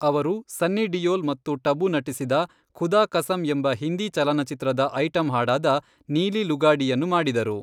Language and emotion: Kannada, neutral